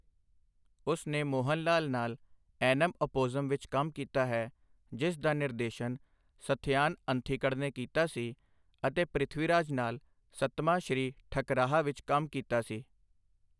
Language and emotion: Punjabi, neutral